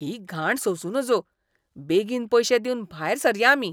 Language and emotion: Goan Konkani, disgusted